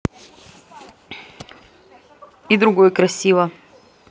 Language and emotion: Russian, neutral